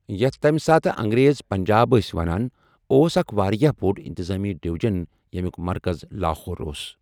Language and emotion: Kashmiri, neutral